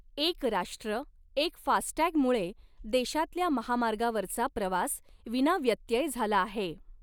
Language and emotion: Marathi, neutral